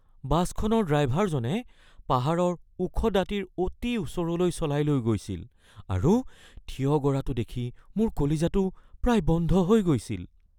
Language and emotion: Assamese, fearful